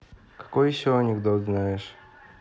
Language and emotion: Russian, neutral